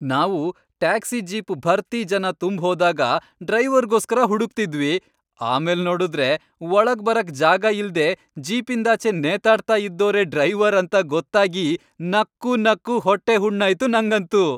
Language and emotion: Kannada, happy